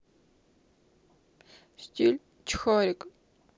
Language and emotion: Russian, sad